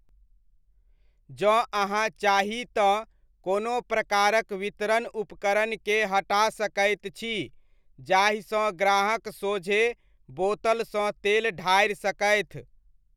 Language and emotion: Maithili, neutral